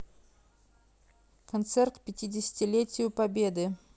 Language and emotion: Russian, neutral